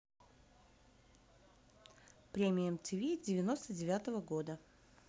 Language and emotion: Russian, neutral